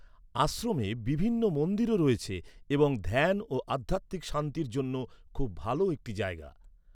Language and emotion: Bengali, neutral